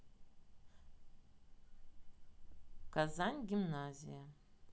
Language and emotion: Russian, neutral